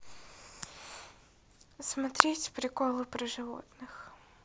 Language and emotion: Russian, neutral